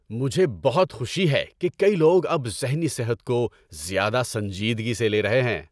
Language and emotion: Urdu, happy